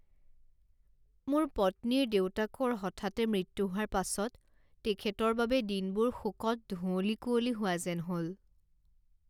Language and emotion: Assamese, sad